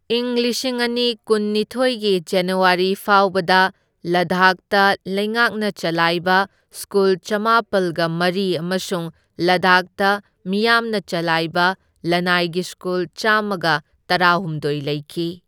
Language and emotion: Manipuri, neutral